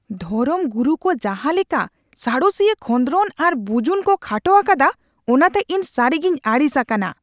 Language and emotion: Santali, angry